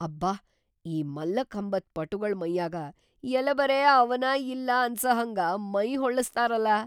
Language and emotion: Kannada, surprised